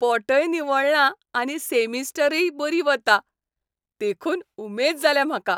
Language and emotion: Goan Konkani, happy